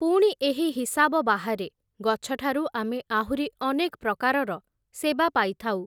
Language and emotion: Odia, neutral